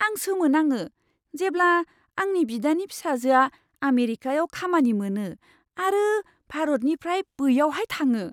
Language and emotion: Bodo, surprised